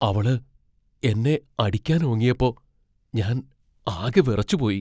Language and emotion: Malayalam, fearful